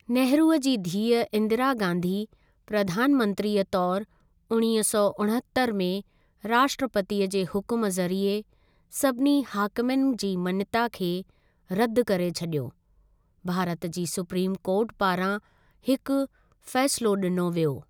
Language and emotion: Sindhi, neutral